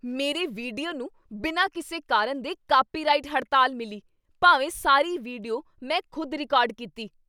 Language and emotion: Punjabi, angry